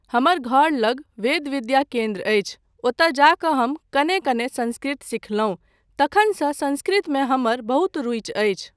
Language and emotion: Maithili, neutral